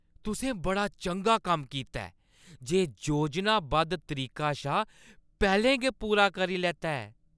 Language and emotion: Dogri, happy